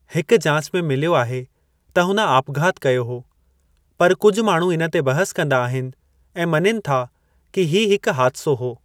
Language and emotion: Sindhi, neutral